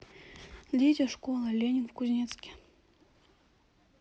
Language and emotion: Russian, neutral